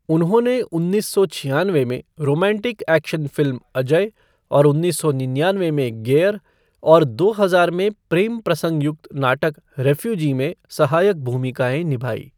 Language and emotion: Hindi, neutral